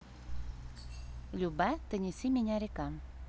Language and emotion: Russian, neutral